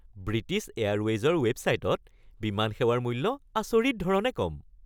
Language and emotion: Assamese, happy